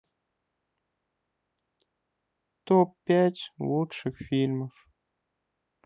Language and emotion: Russian, neutral